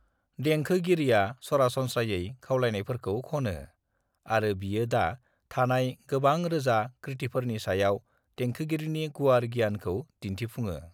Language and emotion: Bodo, neutral